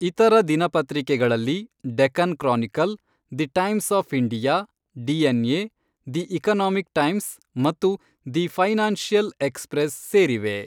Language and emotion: Kannada, neutral